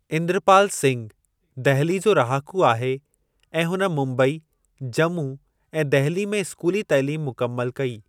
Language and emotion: Sindhi, neutral